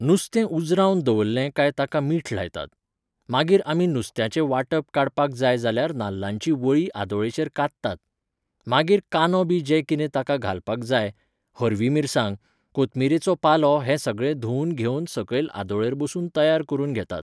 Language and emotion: Goan Konkani, neutral